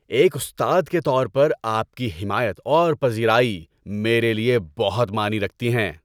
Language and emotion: Urdu, happy